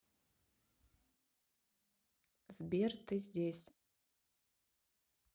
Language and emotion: Russian, neutral